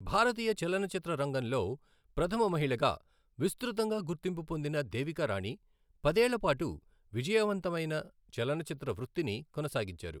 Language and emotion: Telugu, neutral